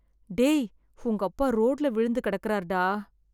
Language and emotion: Tamil, sad